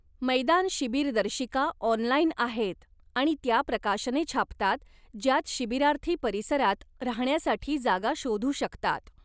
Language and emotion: Marathi, neutral